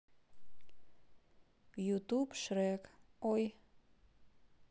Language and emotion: Russian, neutral